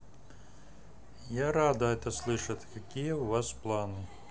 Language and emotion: Russian, neutral